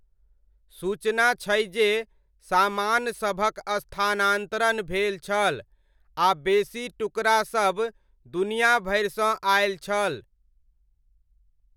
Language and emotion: Maithili, neutral